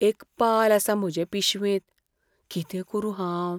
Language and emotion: Goan Konkani, fearful